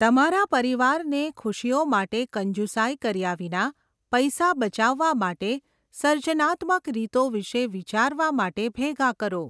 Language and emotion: Gujarati, neutral